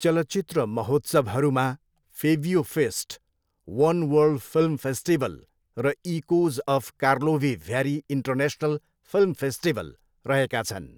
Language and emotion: Nepali, neutral